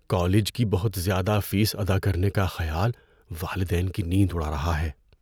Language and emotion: Urdu, fearful